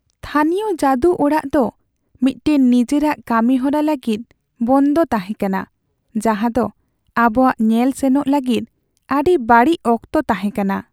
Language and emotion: Santali, sad